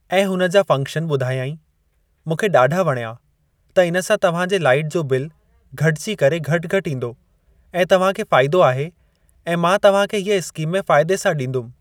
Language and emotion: Sindhi, neutral